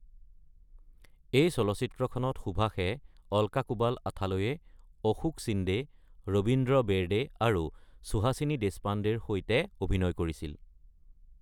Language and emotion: Assamese, neutral